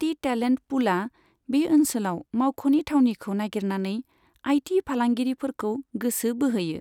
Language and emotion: Bodo, neutral